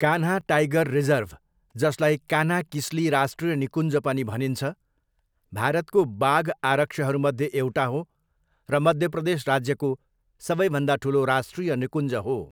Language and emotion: Nepali, neutral